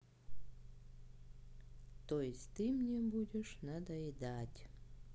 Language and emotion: Russian, sad